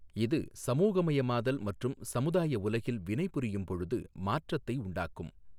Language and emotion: Tamil, neutral